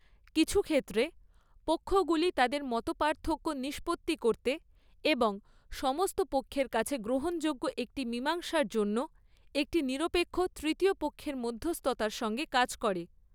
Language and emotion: Bengali, neutral